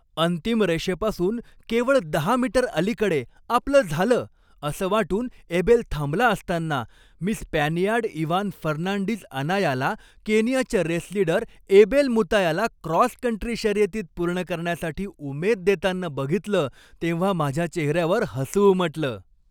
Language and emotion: Marathi, happy